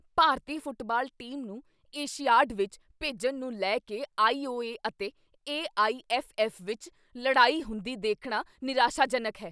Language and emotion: Punjabi, angry